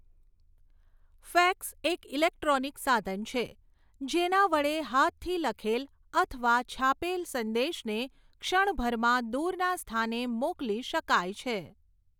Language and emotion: Gujarati, neutral